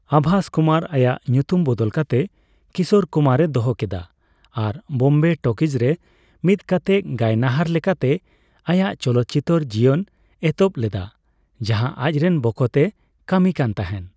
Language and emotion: Santali, neutral